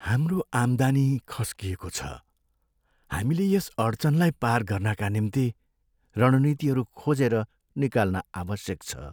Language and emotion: Nepali, sad